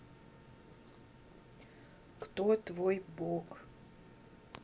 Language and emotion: Russian, neutral